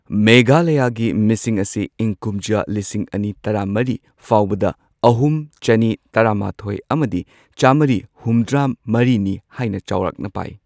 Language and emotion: Manipuri, neutral